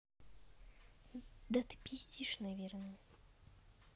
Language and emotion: Russian, neutral